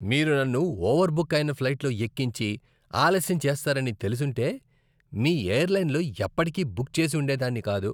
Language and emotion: Telugu, disgusted